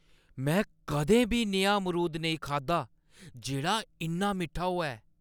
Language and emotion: Dogri, surprised